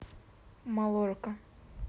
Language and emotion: Russian, neutral